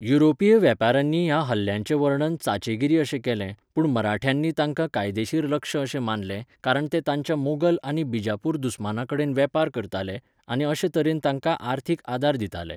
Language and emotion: Goan Konkani, neutral